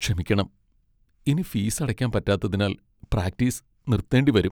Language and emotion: Malayalam, sad